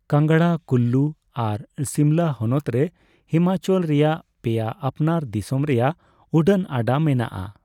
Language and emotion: Santali, neutral